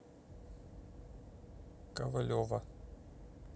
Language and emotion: Russian, neutral